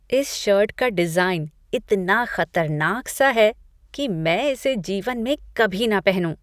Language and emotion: Hindi, disgusted